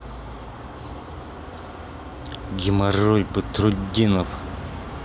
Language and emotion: Russian, angry